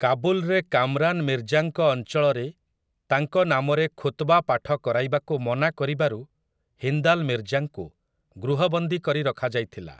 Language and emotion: Odia, neutral